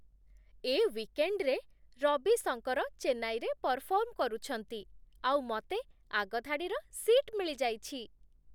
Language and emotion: Odia, happy